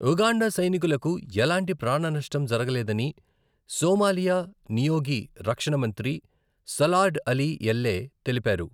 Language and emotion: Telugu, neutral